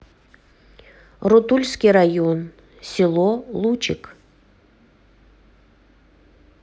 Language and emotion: Russian, neutral